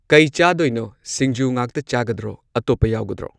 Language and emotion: Manipuri, neutral